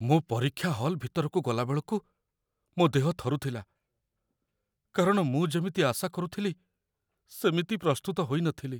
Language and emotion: Odia, fearful